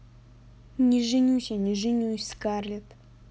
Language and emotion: Russian, neutral